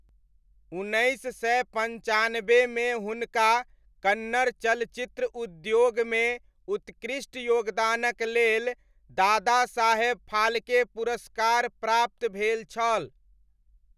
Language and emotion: Maithili, neutral